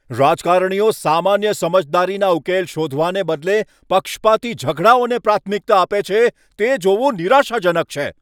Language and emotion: Gujarati, angry